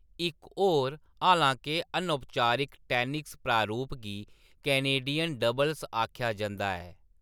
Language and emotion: Dogri, neutral